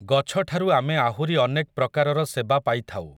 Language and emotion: Odia, neutral